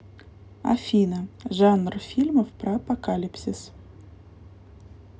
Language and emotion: Russian, neutral